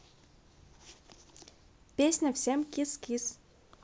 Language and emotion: Russian, neutral